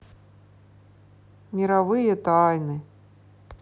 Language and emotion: Russian, sad